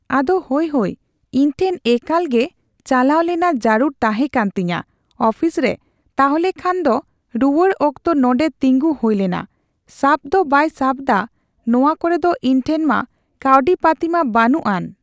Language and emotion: Santali, neutral